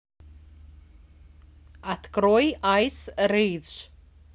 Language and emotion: Russian, neutral